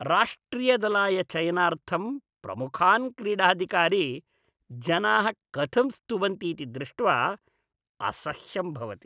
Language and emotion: Sanskrit, disgusted